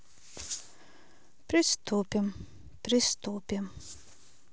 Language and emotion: Russian, neutral